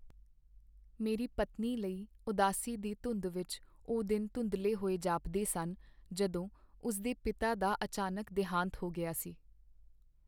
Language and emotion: Punjabi, sad